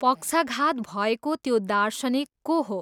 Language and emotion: Nepali, neutral